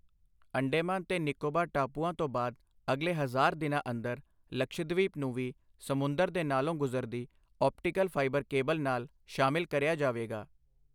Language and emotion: Punjabi, neutral